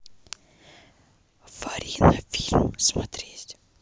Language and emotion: Russian, neutral